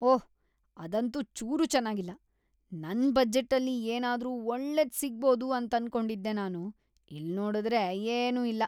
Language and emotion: Kannada, disgusted